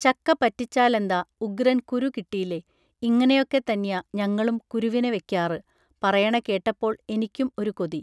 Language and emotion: Malayalam, neutral